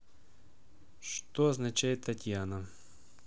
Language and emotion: Russian, neutral